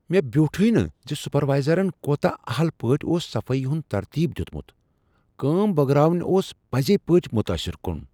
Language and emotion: Kashmiri, surprised